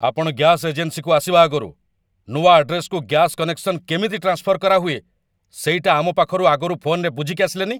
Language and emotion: Odia, angry